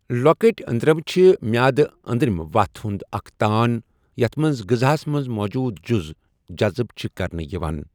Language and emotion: Kashmiri, neutral